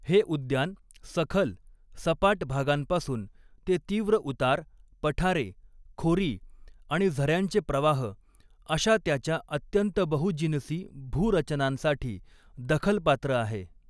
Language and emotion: Marathi, neutral